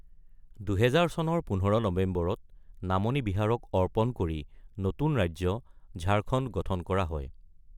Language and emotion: Assamese, neutral